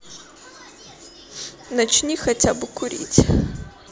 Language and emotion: Russian, sad